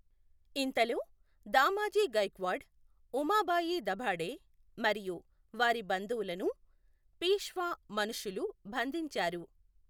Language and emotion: Telugu, neutral